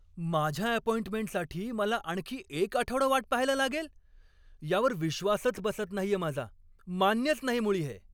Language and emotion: Marathi, angry